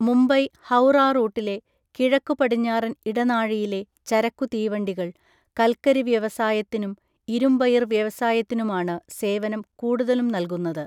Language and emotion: Malayalam, neutral